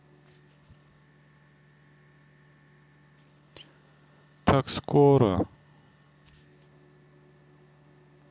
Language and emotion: Russian, sad